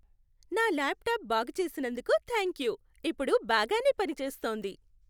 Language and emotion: Telugu, happy